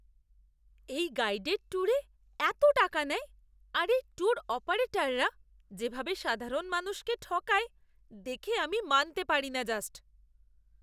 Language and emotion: Bengali, disgusted